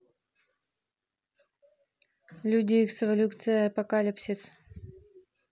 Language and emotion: Russian, neutral